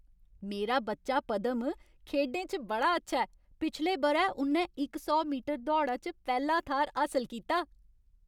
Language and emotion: Dogri, happy